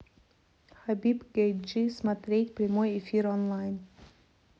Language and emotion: Russian, neutral